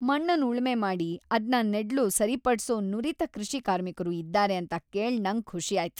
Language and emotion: Kannada, happy